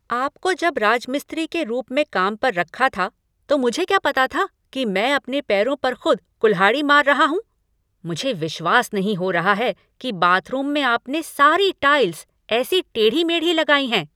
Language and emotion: Hindi, angry